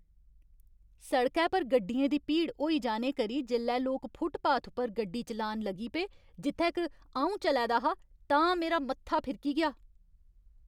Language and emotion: Dogri, angry